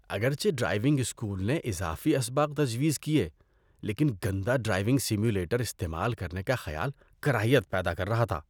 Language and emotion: Urdu, disgusted